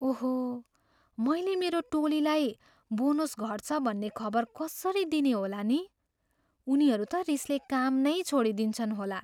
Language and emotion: Nepali, fearful